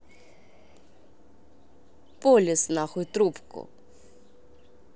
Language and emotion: Russian, angry